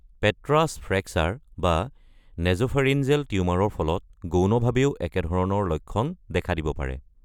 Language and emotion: Assamese, neutral